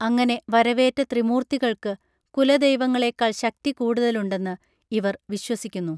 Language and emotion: Malayalam, neutral